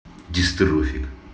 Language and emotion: Russian, angry